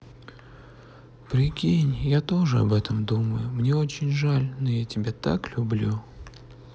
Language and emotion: Russian, sad